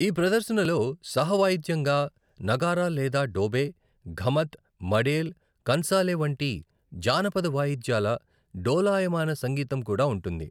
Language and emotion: Telugu, neutral